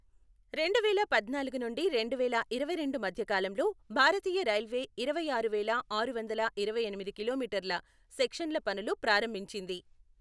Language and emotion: Telugu, neutral